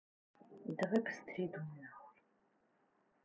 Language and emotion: Russian, neutral